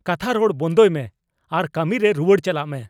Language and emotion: Santali, angry